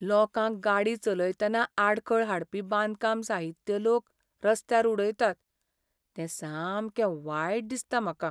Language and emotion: Goan Konkani, sad